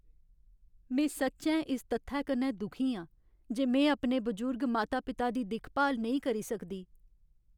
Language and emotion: Dogri, sad